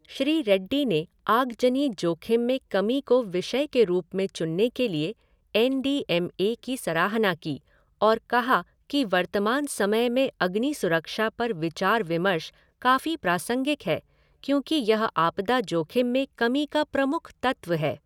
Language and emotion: Hindi, neutral